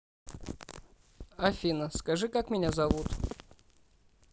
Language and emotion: Russian, neutral